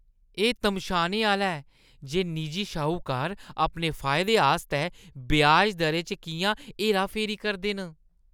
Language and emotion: Dogri, disgusted